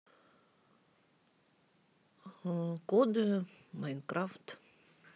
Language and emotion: Russian, neutral